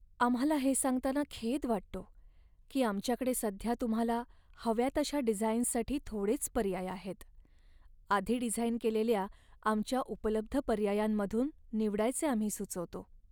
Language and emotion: Marathi, sad